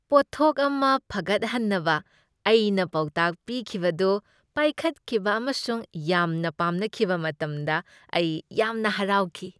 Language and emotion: Manipuri, happy